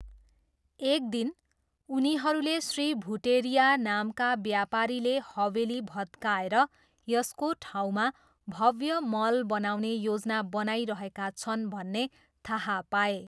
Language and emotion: Nepali, neutral